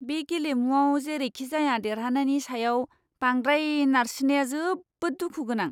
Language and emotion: Bodo, disgusted